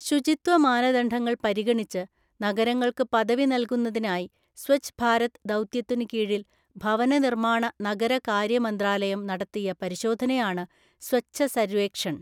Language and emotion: Malayalam, neutral